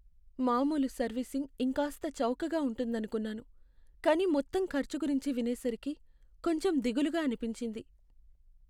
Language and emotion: Telugu, sad